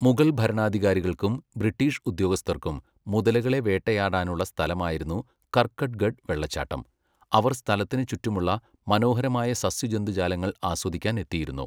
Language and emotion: Malayalam, neutral